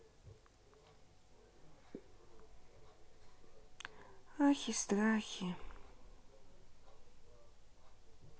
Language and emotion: Russian, sad